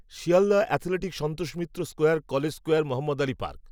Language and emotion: Bengali, neutral